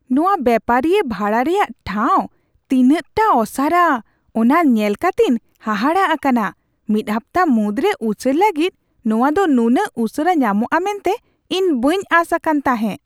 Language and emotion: Santali, surprised